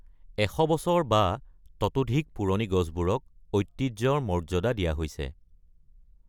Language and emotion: Assamese, neutral